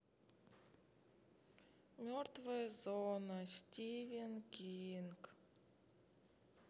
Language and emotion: Russian, sad